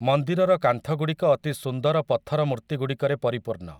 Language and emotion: Odia, neutral